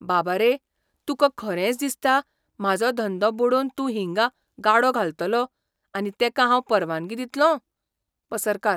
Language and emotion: Goan Konkani, surprised